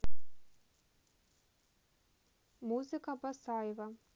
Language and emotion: Russian, neutral